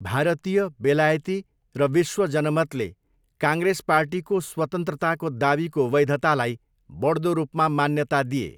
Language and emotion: Nepali, neutral